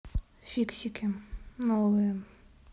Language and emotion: Russian, neutral